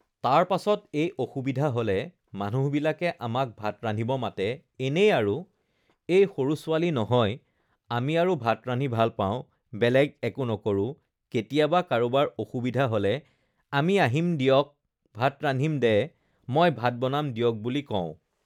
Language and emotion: Assamese, neutral